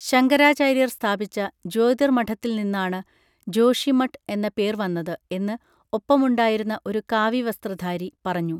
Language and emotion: Malayalam, neutral